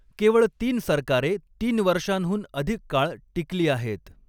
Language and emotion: Marathi, neutral